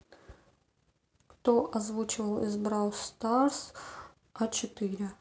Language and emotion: Russian, neutral